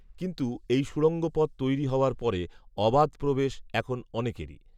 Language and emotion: Bengali, neutral